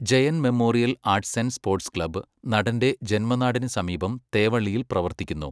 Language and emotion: Malayalam, neutral